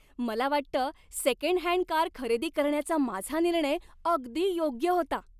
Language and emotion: Marathi, happy